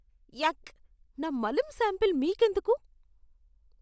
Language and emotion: Telugu, disgusted